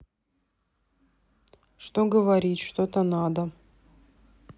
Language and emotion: Russian, sad